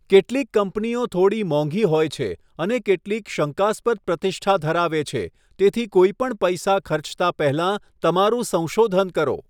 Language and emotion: Gujarati, neutral